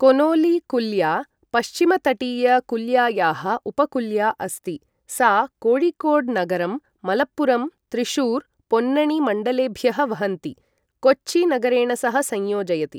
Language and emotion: Sanskrit, neutral